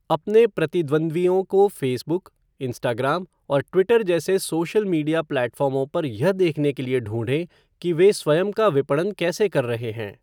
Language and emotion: Hindi, neutral